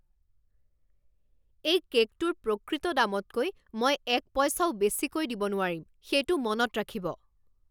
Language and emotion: Assamese, angry